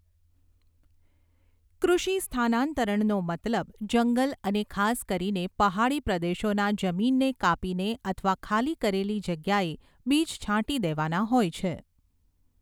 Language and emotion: Gujarati, neutral